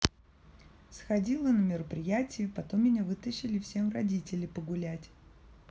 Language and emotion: Russian, neutral